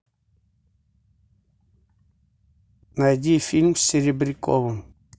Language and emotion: Russian, neutral